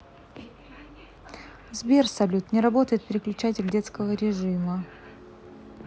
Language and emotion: Russian, neutral